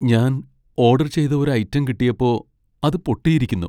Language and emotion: Malayalam, sad